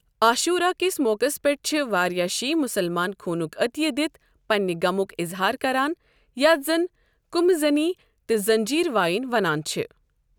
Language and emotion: Kashmiri, neutral